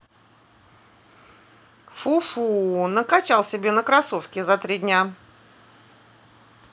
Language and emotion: Russian, neutral